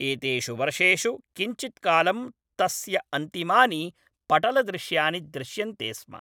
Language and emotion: Sanskrit, neutral